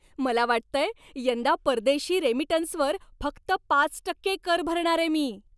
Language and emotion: Marathi, happy